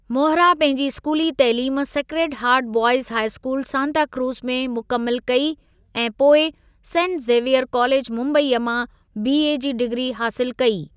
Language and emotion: Sindhi, neutral